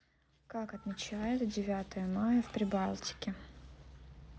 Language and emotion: Russian, neutral